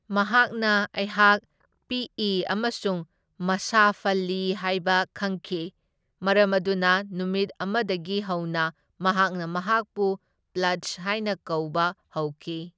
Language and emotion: Manipuri, neutral